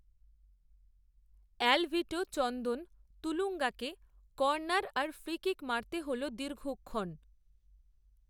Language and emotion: Bengali, neutral